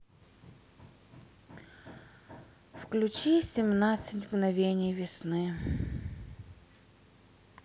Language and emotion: Russian, sad